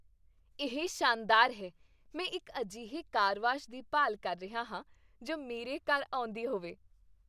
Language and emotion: Punjabi, happy